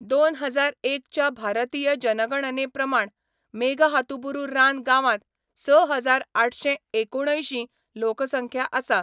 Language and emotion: Goan Konkani, neutral